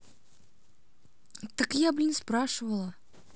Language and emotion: Russian, angry